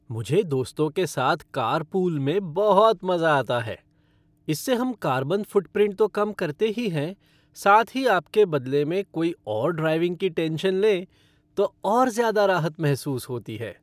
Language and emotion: Hindi, happy